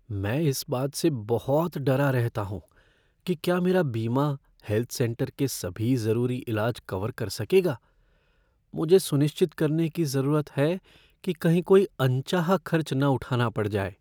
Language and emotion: Hindi, fearful